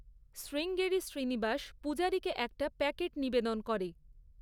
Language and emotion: Bengali, neutral